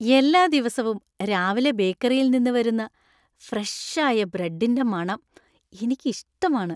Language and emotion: Malayalam, happy